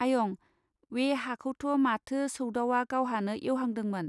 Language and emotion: Bodo, neutral